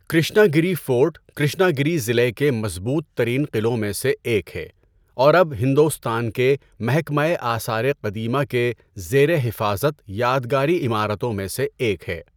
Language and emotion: Urdu, neutral